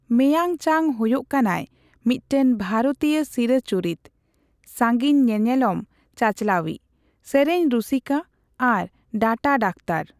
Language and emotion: Santali, neutral